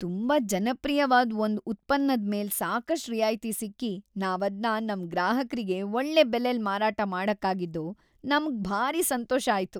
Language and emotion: Kannada, happy